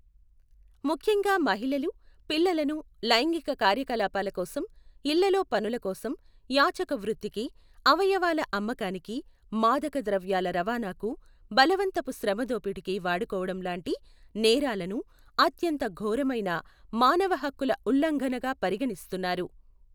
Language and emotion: Telugu, neutral